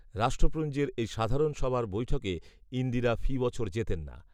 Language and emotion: Bengali, neutral